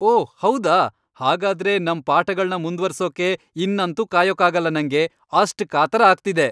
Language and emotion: Kannada, happy